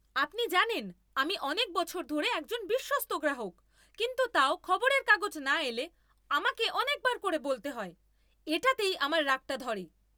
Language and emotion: Bengali, angry